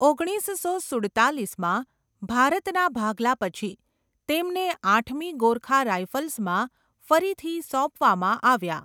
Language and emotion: Gujarati, neutral